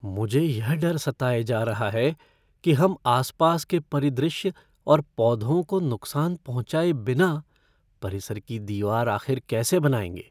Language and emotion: Hindi, fearful